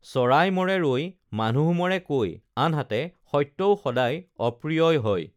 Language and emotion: Assamese, neutral